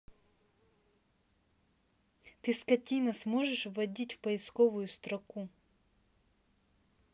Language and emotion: Russian, angry